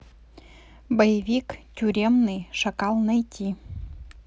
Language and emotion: Russian, neutral